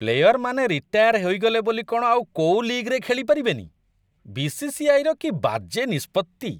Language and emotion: Odia, disgusted